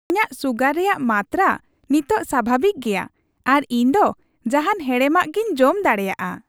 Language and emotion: Santali, happy